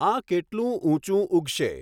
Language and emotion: Gujarati, neutral